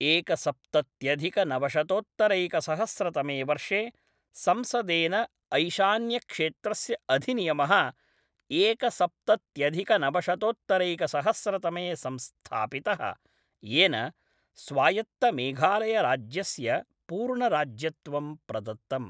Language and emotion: Sanskrit, neutral